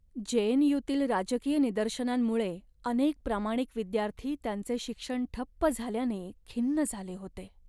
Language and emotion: Marathi, sad